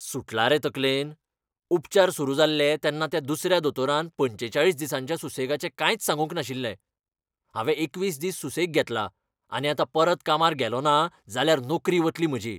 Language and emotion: Goan Konkani, angry